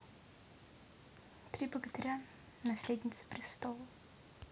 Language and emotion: Russian, neutral